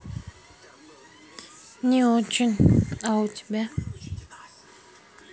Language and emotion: Russian, sad